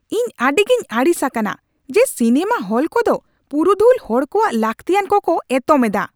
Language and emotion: Santali, angry